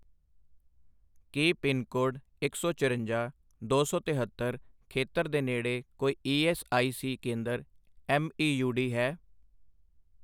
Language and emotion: Punjabi, neutral